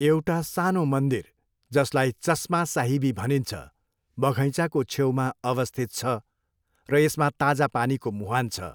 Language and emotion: Nepali, neutral